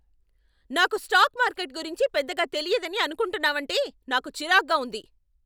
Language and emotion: Telugu, angry